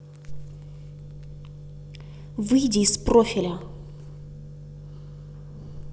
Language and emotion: Russian, angry